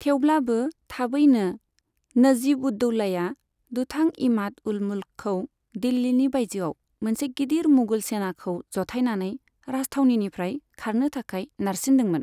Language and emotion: Bodo, neutral